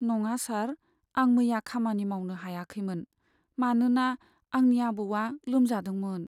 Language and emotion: Bodo, sad